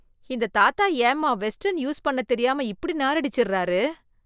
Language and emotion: Tamil, disgusted